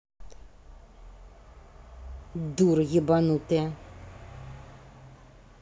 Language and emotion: Russian, angry